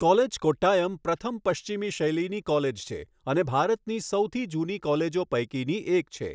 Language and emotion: Gujarati, neutral